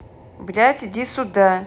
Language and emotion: Russian, neutral